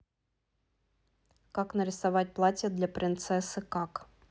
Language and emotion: Russian, neutral